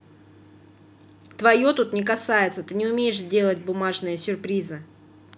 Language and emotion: Russian, angry